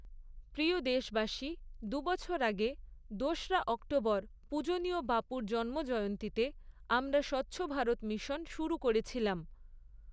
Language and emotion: Bengali, neutral